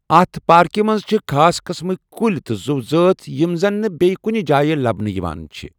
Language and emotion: Kashmiri, neutral